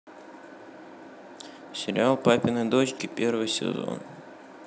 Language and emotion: Russian, neutral